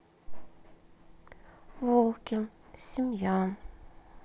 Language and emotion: Russian, sad